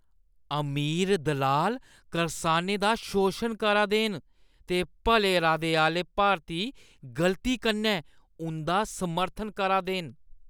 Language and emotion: Dogri, disgusted